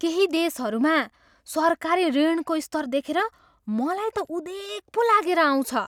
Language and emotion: Nepali, surprised